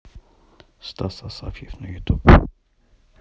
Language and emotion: Russian, neutral